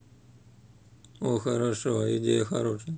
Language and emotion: Russian, neutral